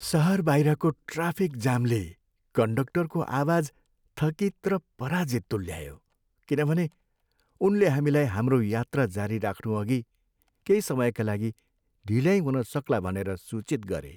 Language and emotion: Nepali, sad